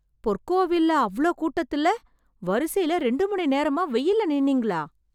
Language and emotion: Tamil, surprised